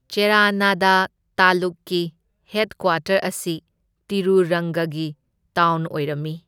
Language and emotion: Manipuri, neutral